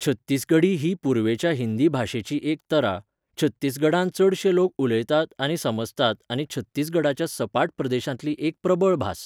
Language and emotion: Goan Konkani, neutral